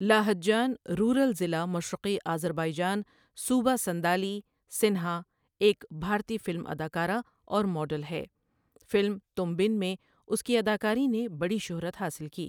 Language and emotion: Urdu, neutral